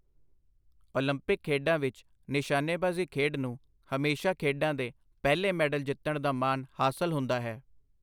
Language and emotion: Punjabi, neutral